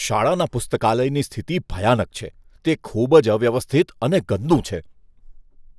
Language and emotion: Gujarati, disgusted